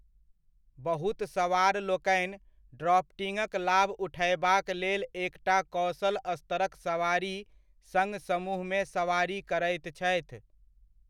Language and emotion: Maithili, neutral